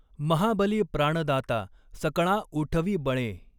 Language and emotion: Marathi, neutral